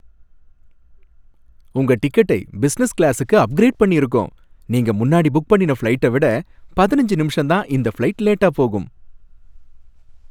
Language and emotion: Tamil, happy